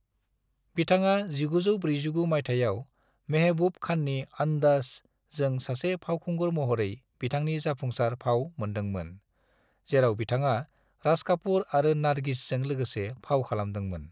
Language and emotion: Bodo, neutral